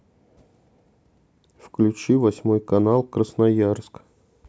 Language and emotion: Russian, neutral